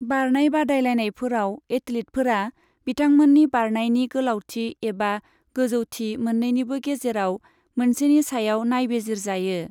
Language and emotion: Bodo, neutral